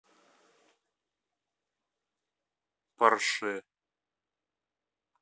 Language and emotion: Russian, neutral